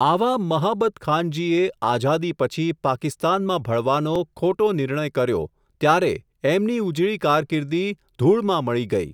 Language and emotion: Gujarati, neutral